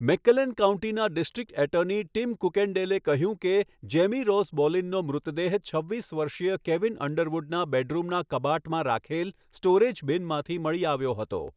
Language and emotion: Gujarati, neutral